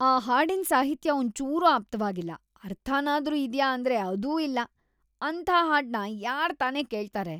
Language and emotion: Kannada, disgusted